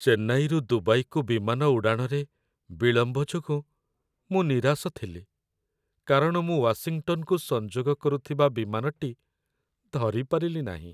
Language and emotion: Odia, sad